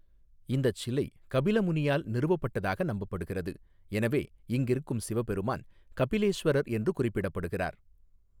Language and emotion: Tamil, neutral